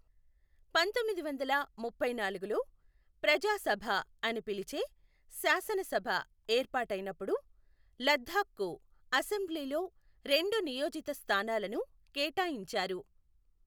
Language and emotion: Telugu, neutral